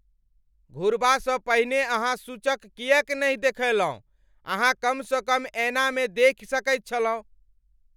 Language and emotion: Maithili, angry